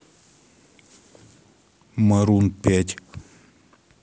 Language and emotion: Russian, neutral